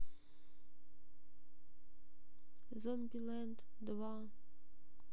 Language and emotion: Russian, sad